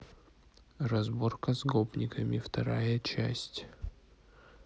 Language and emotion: Russian, neutral